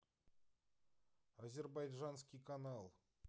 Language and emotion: Russian, neutral